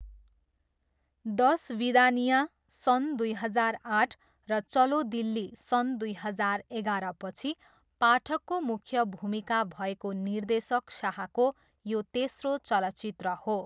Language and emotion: Nepali, neutral